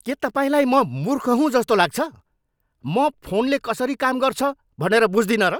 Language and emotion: Nepali, angry